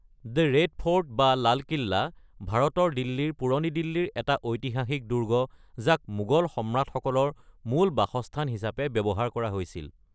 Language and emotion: Assamese, neutral